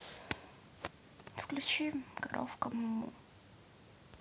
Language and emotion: Russian, sad